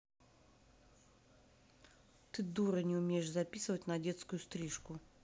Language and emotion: Russian, angry